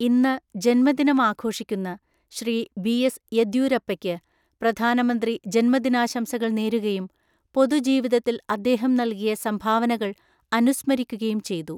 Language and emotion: Malayalam, neutral